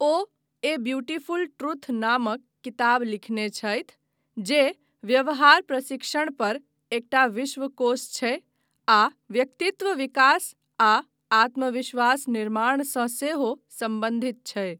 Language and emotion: Maithili, neutral